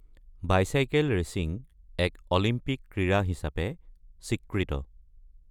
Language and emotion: Assamese, neutral